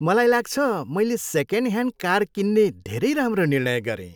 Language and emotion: Nepali, happy